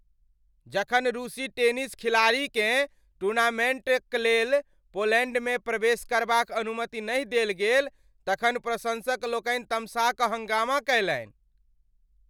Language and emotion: Maithili, angry